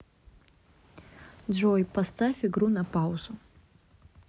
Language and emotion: Russian, neutral